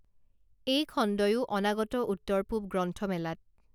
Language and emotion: Assamese, neutral